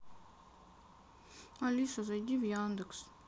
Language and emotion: Russian, sad